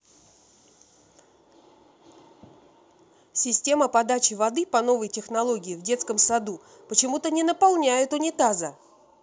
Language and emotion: Russian, angry